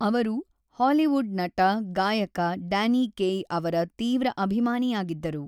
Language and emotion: Kannada, neutral